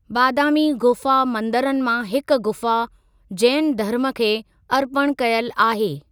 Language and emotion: Sindhi, neutral